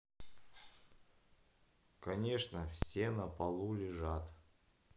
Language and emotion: Russian, neutral